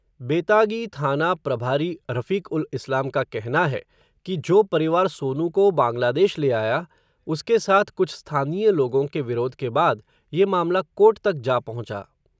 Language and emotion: Hindi, neutral